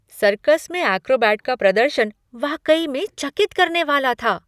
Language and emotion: Hindi, surprised